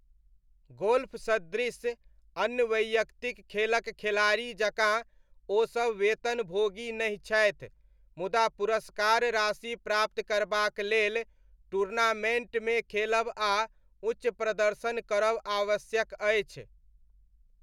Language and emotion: Maithili, neutral